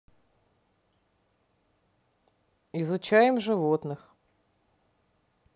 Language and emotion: Russian, neutral